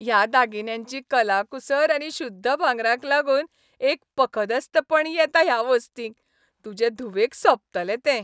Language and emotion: Goan Konkani, happy